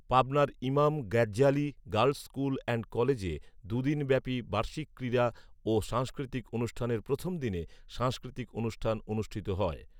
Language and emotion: Bengali, neutral